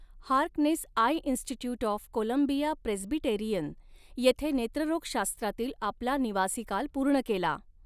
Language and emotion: Marathi, neutral